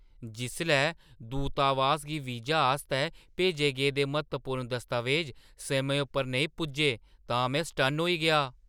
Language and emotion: Dogri, surprised